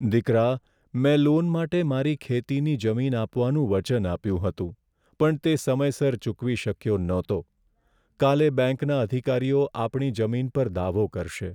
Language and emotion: Gujarati, sad